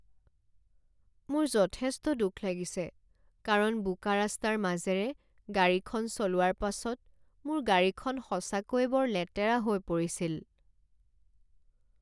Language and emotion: Assamese, sad